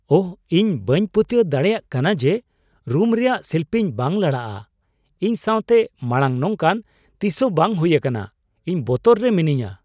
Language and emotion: Santali, surprised